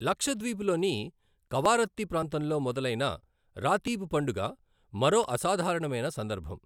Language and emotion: Telugu, neutral